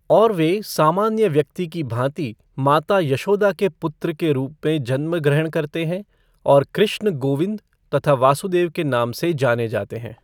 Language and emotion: Hindi, neutral